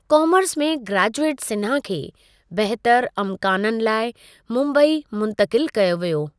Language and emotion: Sindhi, neutral